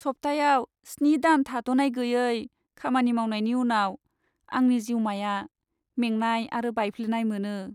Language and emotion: Bodo, sad